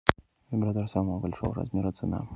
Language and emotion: Russian, neutral